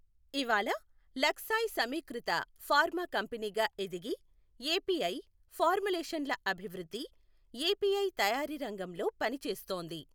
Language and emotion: Telugu, neutral